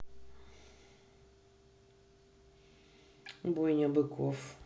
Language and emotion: Russian, neutral